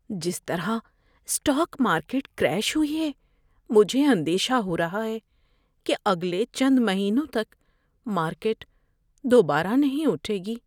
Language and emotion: Urdu, fearful